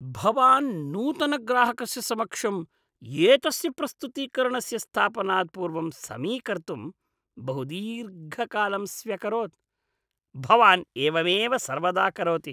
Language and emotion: Sanskrit, disgusted